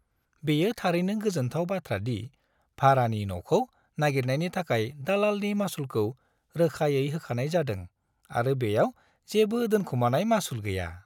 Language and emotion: Bodo, happy